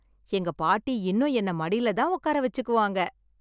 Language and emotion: Tamil, happy